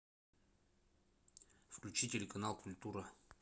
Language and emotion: Russian, neutral